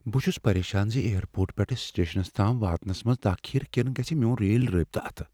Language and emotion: Kashmiri, fearful